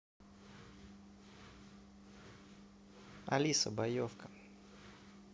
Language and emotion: Russian, neutral